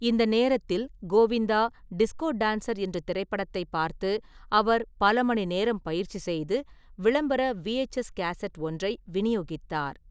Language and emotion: Tamil, neutral